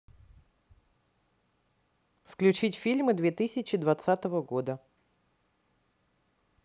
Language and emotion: Russian, neutral